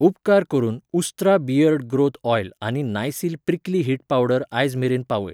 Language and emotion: Goan Konkani, neutral